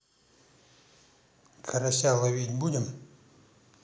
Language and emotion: Russian, neutral